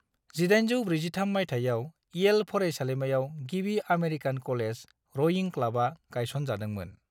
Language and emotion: Bodo, neutral